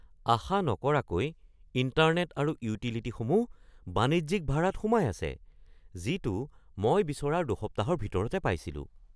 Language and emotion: Assamese, surprised